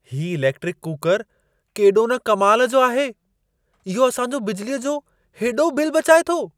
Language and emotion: Sindhi, surprised